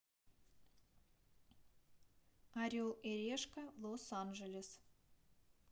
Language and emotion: Russian, neutral